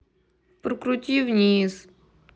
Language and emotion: Russian, sad